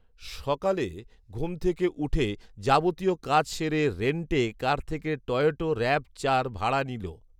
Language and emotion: Bengali, neutral